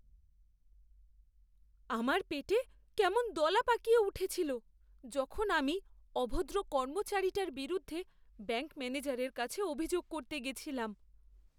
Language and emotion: Bengali, fearful